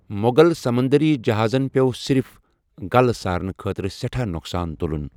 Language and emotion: Kashmiri, neutral